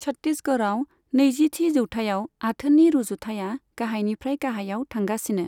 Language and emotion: Bodo, neutral